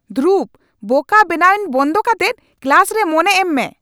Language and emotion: Santali, angry